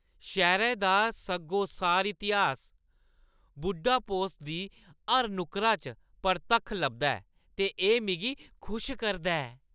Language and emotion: Dogri, happy